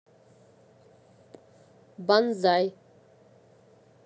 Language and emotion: Russian, neutral